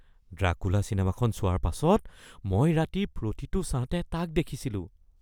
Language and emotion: Assamese, fearful